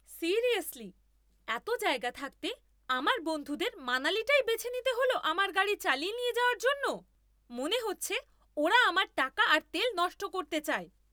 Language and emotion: Bengali, angry